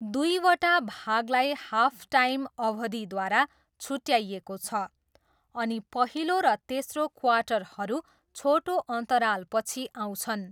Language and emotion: Nepali, neutral